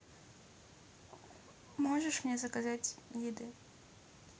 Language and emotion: Russian, neutral